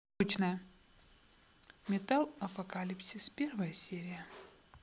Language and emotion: Russian, neutral